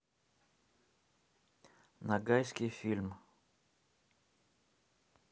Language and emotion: Russian, neutral